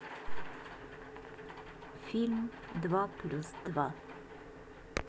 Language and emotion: Russian, neutral